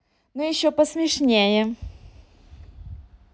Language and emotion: Russian, positive